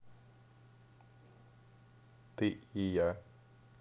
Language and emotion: Russian, neutral